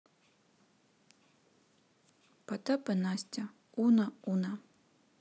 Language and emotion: Russian, neutral